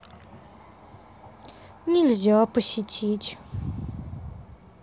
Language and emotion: Russian, sad